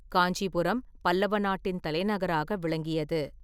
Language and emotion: Tamil, neutral